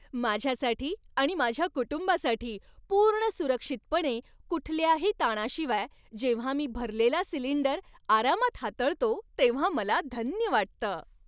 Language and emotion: Marathi, happy